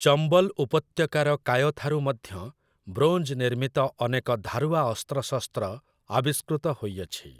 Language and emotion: Odia, neutral